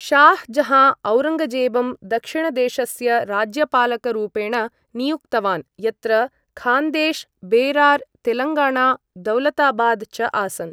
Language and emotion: Sanskrit, neutral